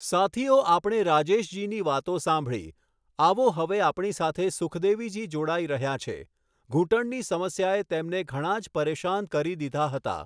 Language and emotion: Gujarati, neutral